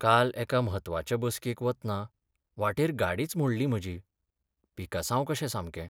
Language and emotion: Goan Konkani, sad